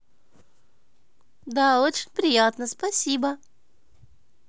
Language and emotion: Russian, positive